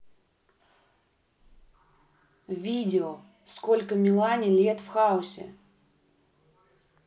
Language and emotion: Russian, neutral